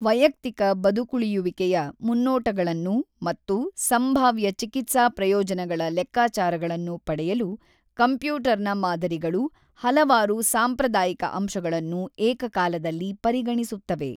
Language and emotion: Kannada, neutral